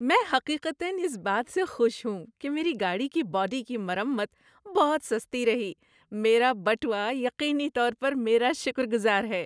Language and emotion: Urdu, happy